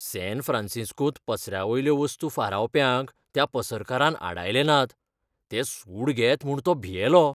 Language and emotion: Goan Konkani, fearful